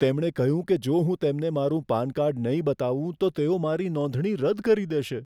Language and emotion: Gujarati, fearful